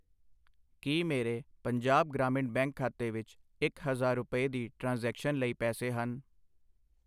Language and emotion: Punjabi, neutral